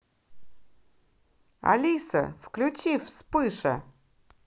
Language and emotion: Russian, positive